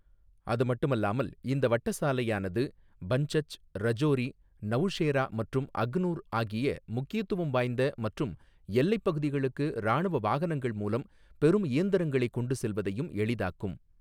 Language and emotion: Tamil, neutral